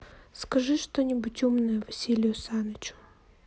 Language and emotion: Russian, sad